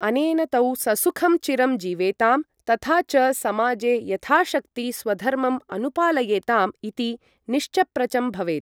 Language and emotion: Sanskrit, neutral